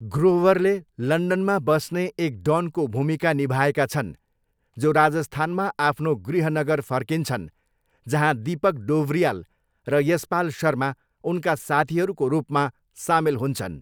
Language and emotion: Nepali, neutral